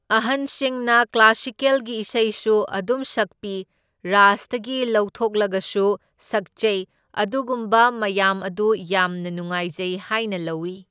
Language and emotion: Manipuri, neutral